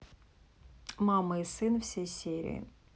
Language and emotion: Russian, neutral